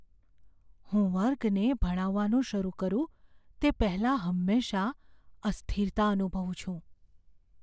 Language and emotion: Gujarati, fearful